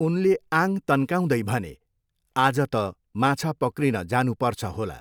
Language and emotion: Nepali, neutral